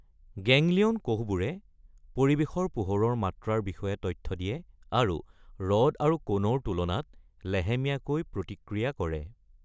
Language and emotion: Assamese, neutral